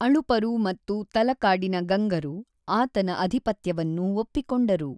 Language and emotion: Kannada, neutral